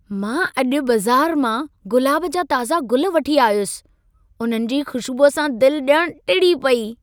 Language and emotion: Sindhi, happy